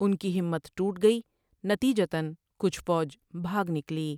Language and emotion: Urdu, neutral